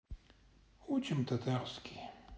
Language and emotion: Russian, sad